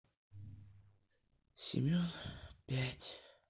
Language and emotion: Russian, sad